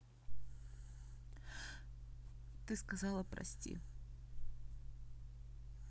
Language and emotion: Russian, sad